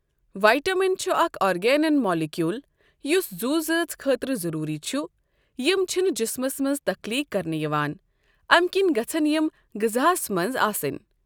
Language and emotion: Kashmiri, neutral